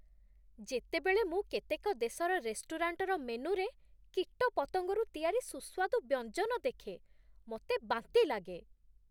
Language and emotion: Odia, disgusted